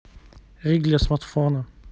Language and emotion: Russian, neutral